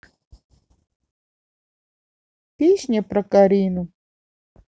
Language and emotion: Russian, neutral